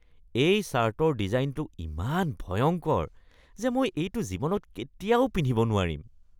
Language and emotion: Assamese, disgusted